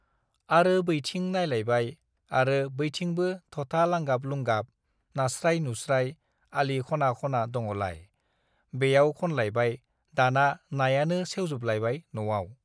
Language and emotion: Bodo, neutral